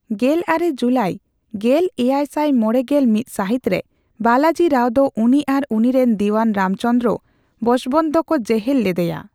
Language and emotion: Santali, neutral